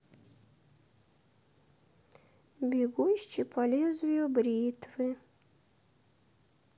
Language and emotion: Russian, sad